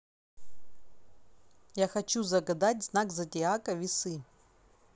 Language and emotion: Russian, neutral